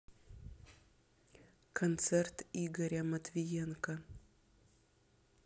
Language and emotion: Russian, neutral